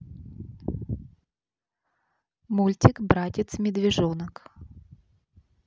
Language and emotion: Russian, neutral